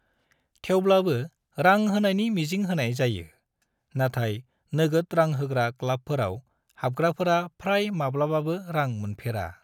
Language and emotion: Bodo, neutral